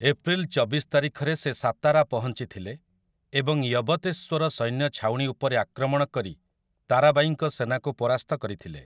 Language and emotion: Odia, neutral